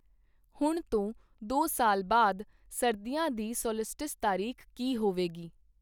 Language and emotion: Punjabi, neutral